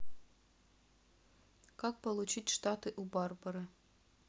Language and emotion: Russian, neutral